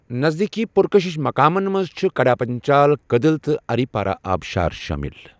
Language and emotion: Kashmiri, neutral